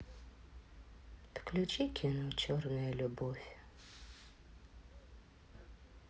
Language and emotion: Russian, sad